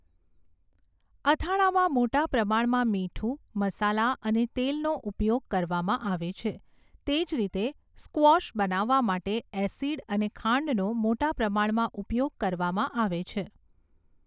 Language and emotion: Gujarati, neutral